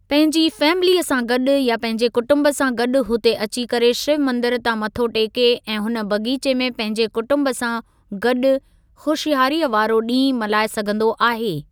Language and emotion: Sindhi, neutral